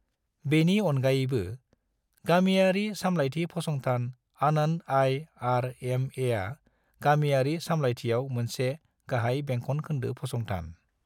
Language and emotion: Bodo, neutral